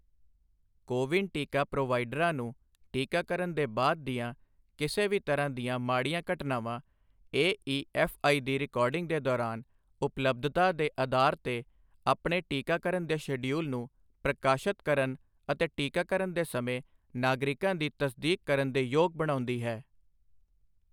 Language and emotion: Punjabi, neutral